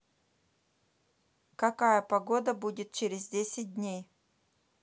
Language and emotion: Russian, neutral